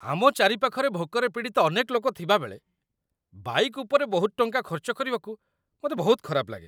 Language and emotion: Odia, disgusted